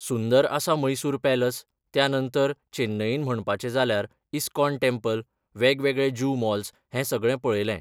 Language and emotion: Goan Konkani, neutral